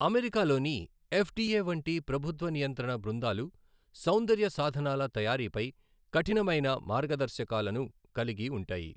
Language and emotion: Telugu, neutral